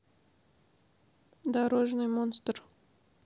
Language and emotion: Russian, neutral